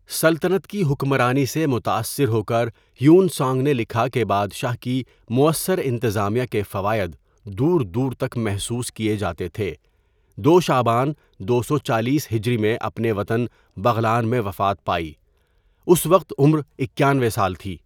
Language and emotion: Urdu, neutral